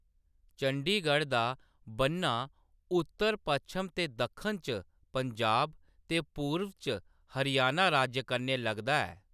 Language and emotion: Dogri, neutral